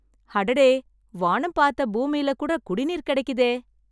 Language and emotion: Tamil, happy